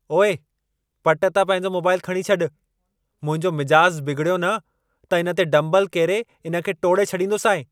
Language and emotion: Sindhi, angry